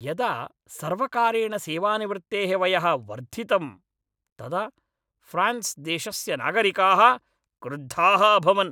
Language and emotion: Sanskrit, angry